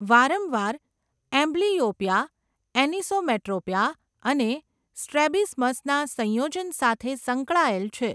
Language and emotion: Gujarati, neutral